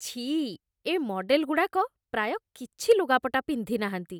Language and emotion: Odia, disgusted